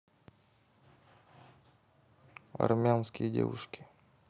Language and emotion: Russian, neutral